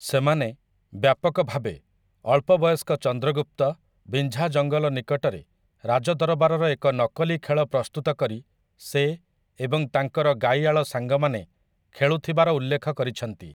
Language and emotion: Odia, neutral